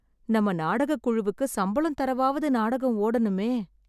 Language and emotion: Tamil, sad